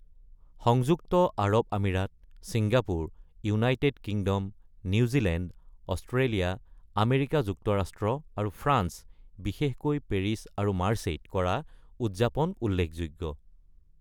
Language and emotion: Assamese, neutral